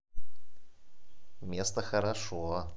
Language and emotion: Russian, positive